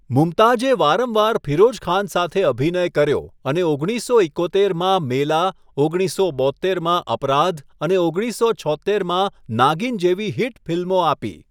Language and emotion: Gujarati, neutral